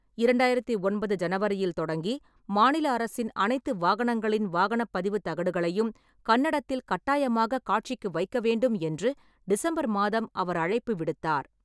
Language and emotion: Tamil, neutral